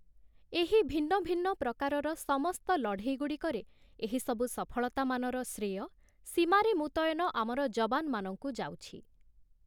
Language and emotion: Odia, neutral